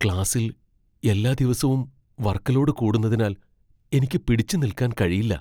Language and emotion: Malayalam, fearful